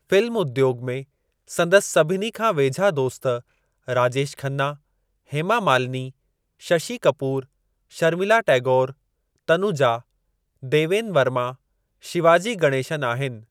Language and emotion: Sindhi, neutral